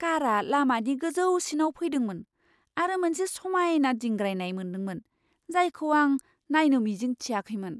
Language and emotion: Bodo, surprised